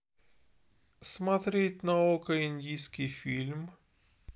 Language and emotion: Russian, neutral